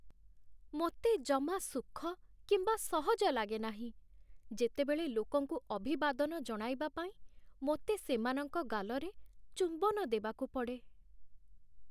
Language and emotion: Odia, sad